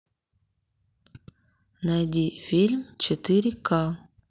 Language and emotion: Russian, neutral